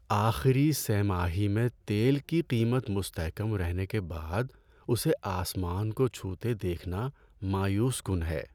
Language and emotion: Urdu, sad